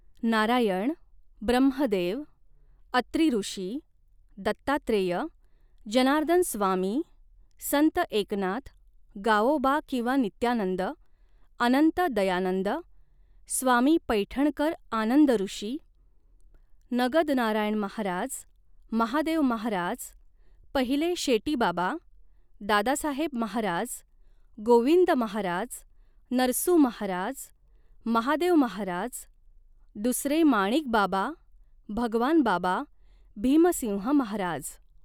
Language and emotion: Marathi, neutral